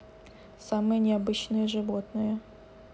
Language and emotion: Russian, neutral